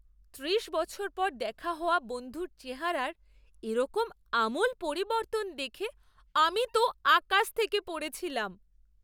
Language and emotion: Bengali, surprised